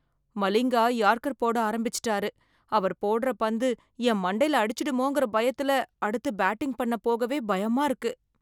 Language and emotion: Tamil, fearful